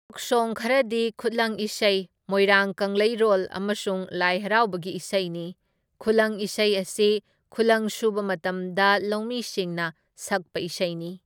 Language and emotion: Manipuri, neutral